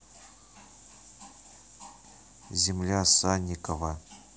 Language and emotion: Russian, neutral